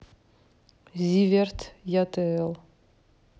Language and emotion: Russian, neutral